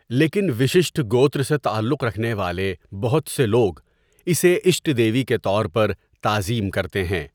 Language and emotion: Urdu, neutral